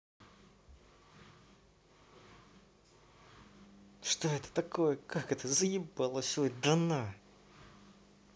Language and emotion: Russian, angry